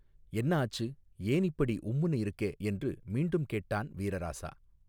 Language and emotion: Tamil, neutral